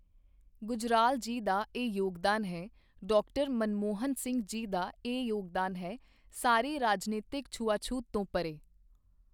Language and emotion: Punjabi, neutral